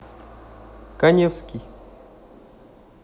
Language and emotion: Russian, neutral